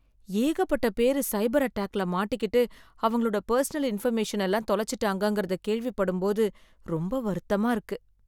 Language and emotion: Tamil, sad